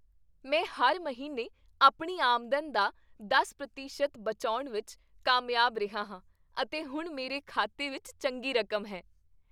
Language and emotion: Punjabi, happy